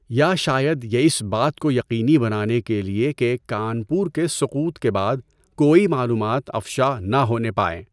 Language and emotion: Urdu, neutral